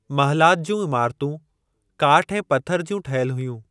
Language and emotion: Sindhi, neutral